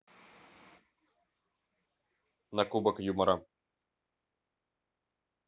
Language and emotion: Russian, neutral